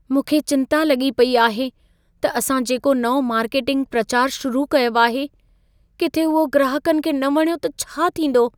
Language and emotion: Sindhi, fearful